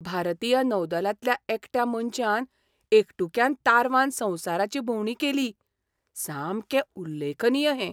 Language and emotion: Goan Konkani, surprised